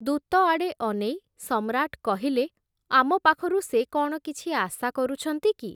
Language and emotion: Odia, neutral